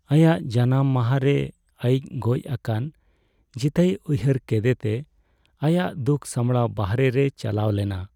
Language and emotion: Santali, sad